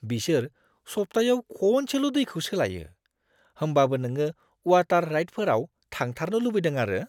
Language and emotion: Bodo, disgusted